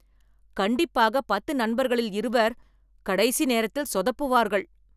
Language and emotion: Tamil, angry